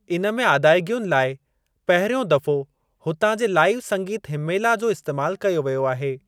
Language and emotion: Sindhi, neutral